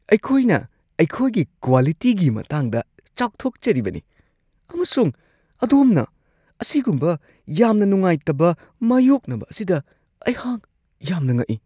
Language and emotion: Manipuri, surprised